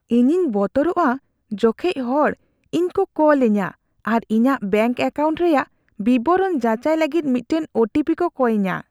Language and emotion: Santali, fearful